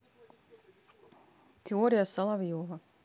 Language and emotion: Russian, neutral